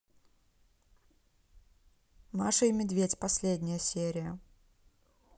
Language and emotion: Russian, neutral